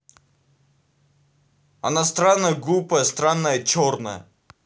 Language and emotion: Russian, angry